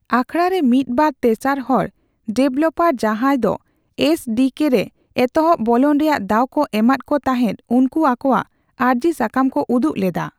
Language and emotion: Santali, neutral